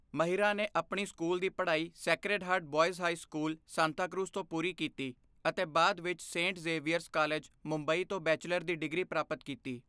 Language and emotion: Punjabi, neutral